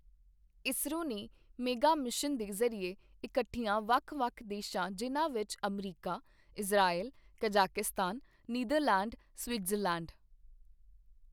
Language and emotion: Punjabi, neutral